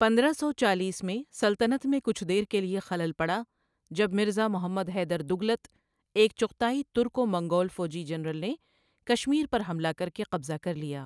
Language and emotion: Urdu, neutral